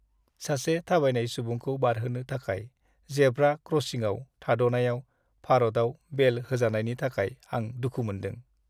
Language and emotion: Bodo, sad